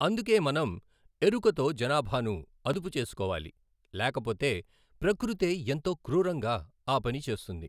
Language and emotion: Telugu, neutral